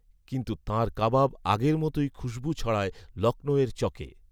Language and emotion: Bengali, neutral